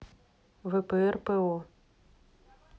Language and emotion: Russian, neutral